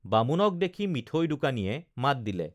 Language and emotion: Assamese, neutral